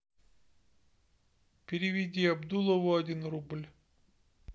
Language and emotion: Russian, neutral